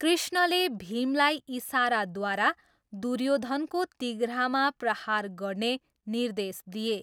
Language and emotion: Nepali, neutral